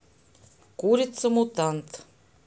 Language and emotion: Russian, neutral